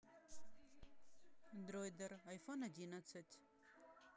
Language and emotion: Russian, neutral